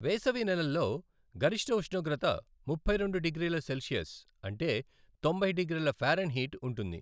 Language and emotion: Telugu, neutral